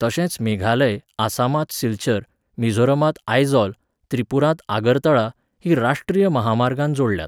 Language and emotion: Goan Konkani, neutral